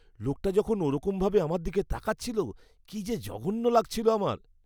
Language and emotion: Bengali, disgusted